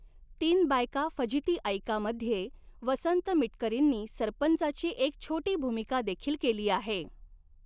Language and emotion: Marathi, neutral